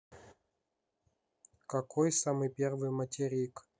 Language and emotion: Russian, neutral